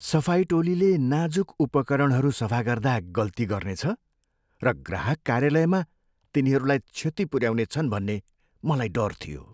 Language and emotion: Nepali, fearful